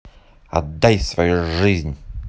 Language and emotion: Russian, neutral